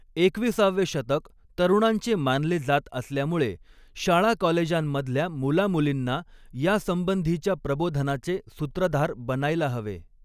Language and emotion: Marathi, neutral